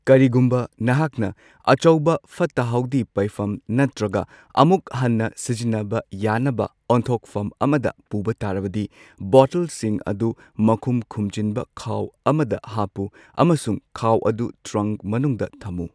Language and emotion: Manipuri, neutral